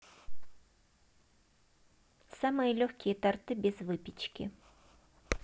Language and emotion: Russian, neutral